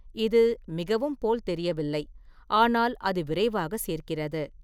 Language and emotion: Tamil, neutral